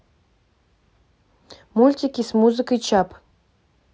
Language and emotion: Russian, neutral